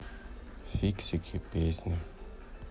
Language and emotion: Russian, sad